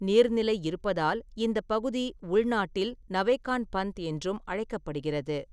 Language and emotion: Tamil, neutral